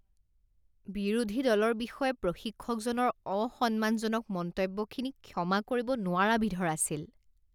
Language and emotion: Assamese, disgusted